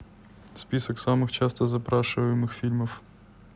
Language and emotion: Russian, neutral